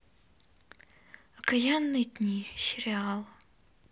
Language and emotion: Russian, sad